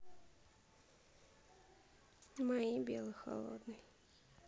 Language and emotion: Russian, sad